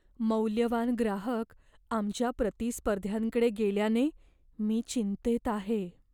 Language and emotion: Marathi, fearful